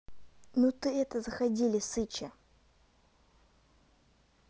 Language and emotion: Russian, neutral